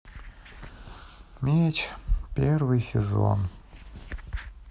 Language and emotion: Russian, sad